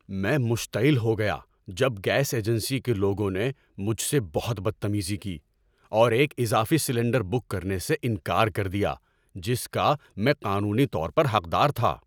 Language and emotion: Urdu, angry